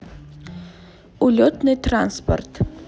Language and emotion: Russian, neutral